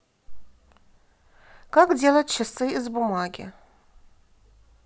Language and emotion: Russian, neutral